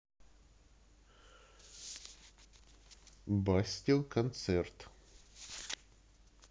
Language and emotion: Russian, neutral